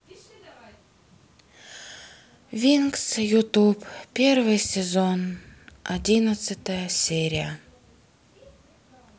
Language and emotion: Russian, sad